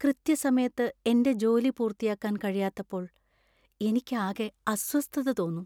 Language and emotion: Malayalam, sad